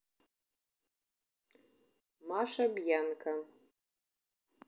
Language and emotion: Russian, neutral